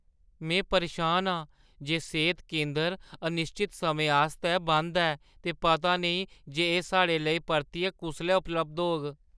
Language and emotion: Dogri, fearful